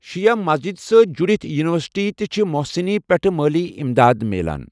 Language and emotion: Kashmiri, neutral